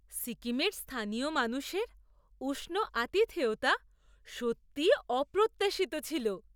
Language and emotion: Bengali, surprised